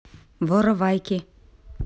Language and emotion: Russian, neutral